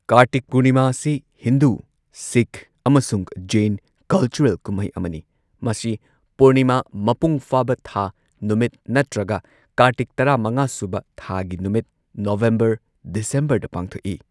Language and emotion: Manipuri, neutral